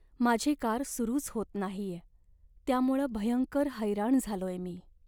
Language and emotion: Marathi, sad